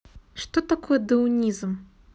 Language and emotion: Russian, neutral